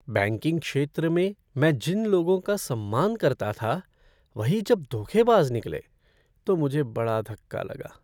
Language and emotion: Hindi, sad